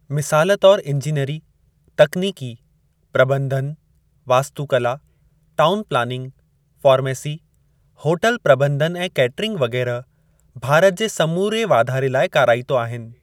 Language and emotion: Sindhi, neutral